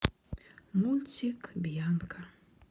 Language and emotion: Russian, sad